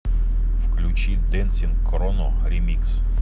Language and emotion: Russian, neutral